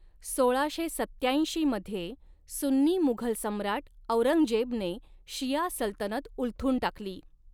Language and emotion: Marathi, neutral